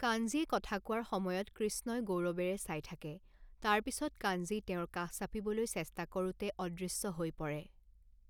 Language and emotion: Assamese, neutral